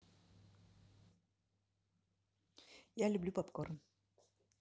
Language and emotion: Russian, neutral